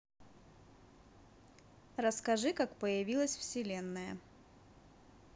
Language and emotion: Russian, neutral